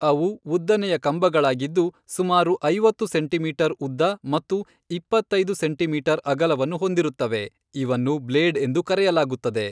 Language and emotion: Kannada, neutral